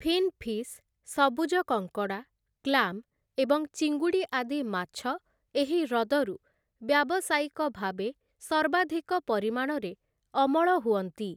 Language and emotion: Odia, neutral